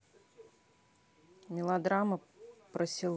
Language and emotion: Russian, neutral